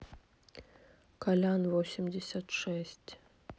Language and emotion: Russian, neutral